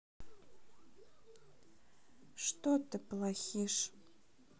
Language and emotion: Russian, sad